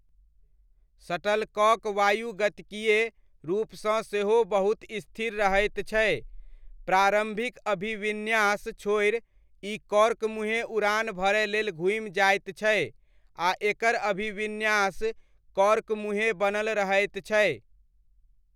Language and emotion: Maithili, neutral